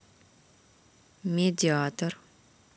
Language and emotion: Russian, neutral